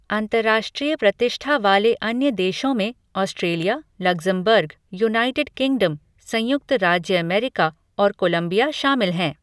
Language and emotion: Hindi, neutral